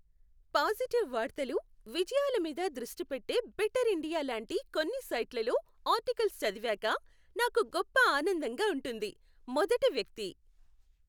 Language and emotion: Telugu, happy